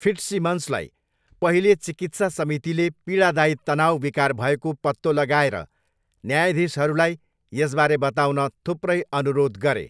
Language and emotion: Nepali, neutral